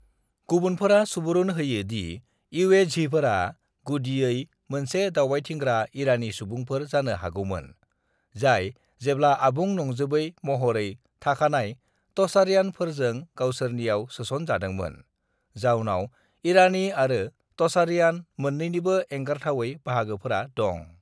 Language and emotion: Bodo, neutral